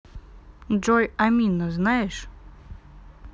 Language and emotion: Russian, neutral